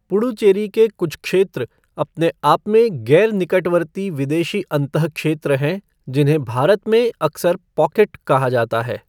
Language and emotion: Hindi, neutral